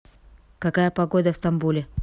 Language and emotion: Russian, neutral